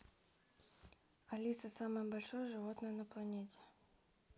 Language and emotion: Russian, neutral